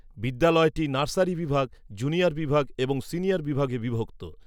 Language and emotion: Bengali, neutral